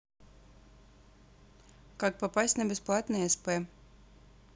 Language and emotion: Russian, neutral